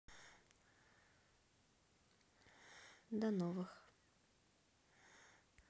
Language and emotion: Russian, neutral